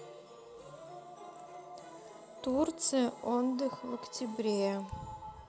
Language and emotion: Russian, neutral